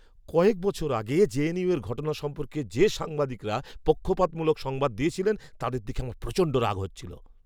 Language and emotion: Bengali, angry